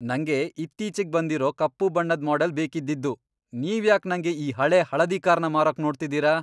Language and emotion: Kannada, angry